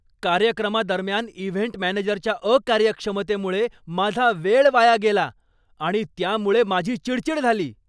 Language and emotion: Marathi, angry